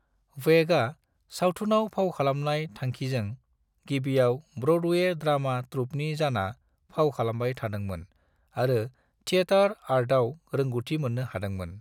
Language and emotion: Bodo, neutral